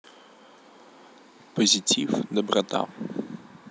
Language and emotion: Russian, neutral